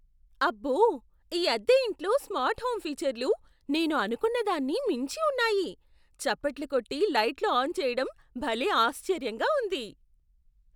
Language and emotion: Telugu, surprised